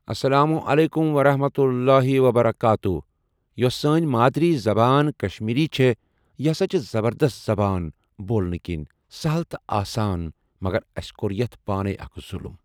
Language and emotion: Kashmiri, neutral